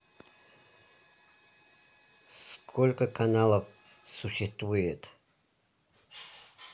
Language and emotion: Russian, neutral